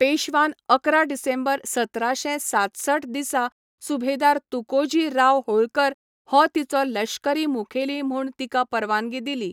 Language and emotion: Goan Konkani, neutral